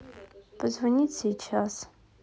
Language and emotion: Russian, neutral